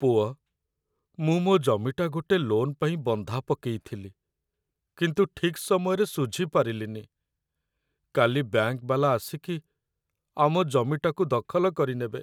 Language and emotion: Odia, sad